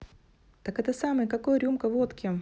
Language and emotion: Russian, positive